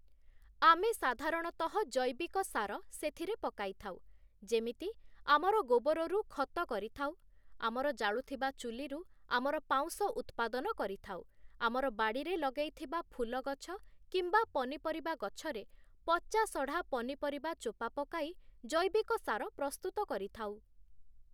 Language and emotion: Odia, neutral